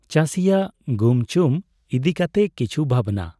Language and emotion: Santali, neutral